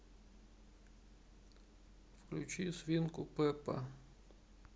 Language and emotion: Russian, sad